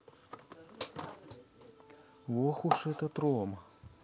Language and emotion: Russian, neutral